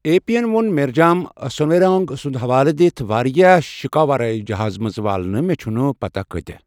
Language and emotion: Kashmiri, neutral